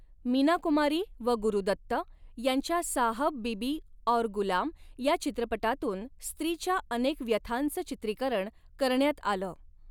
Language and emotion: Marathi, neutral